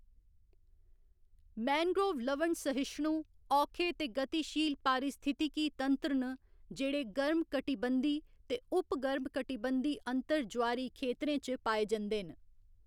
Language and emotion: Dogri, neutral